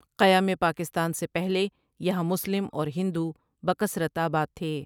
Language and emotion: Urdu, neutral